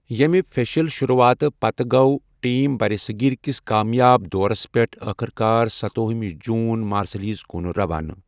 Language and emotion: Kashmiri, neutral